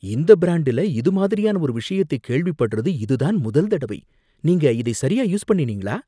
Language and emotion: Tamil, surprised